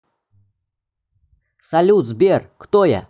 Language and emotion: Russian, positive